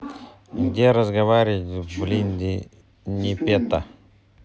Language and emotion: Russian, neutral